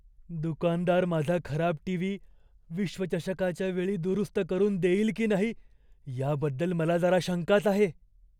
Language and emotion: Marathi, fearful